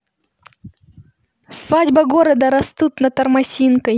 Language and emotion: Russian, neutral